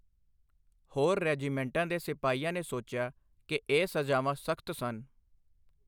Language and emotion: Punjabi, neutral